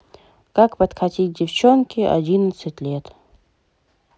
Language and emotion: Russian, neutral